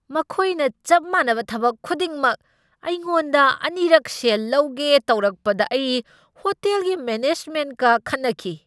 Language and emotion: Manipuri, angry